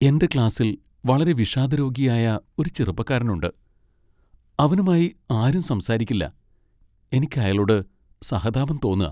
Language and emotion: Malayalam, sad